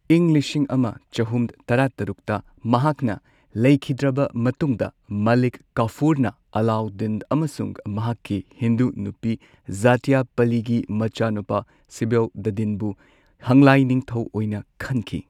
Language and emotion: Manipuri, neutral